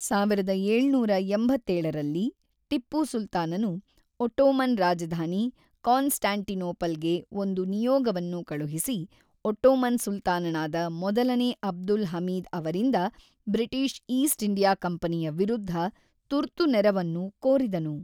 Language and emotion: Kannada, neutral